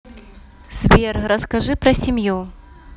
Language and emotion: Russian, neutral